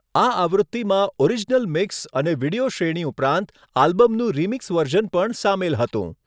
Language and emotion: Gujarati, neutral